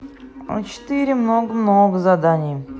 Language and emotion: Russian, neutral